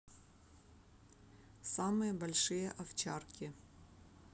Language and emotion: Russian, neutral